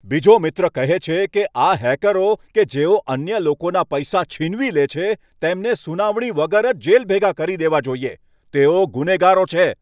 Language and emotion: Gujarati, angry